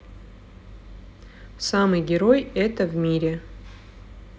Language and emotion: Russian, neutral